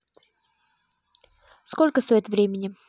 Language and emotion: Russian, neutral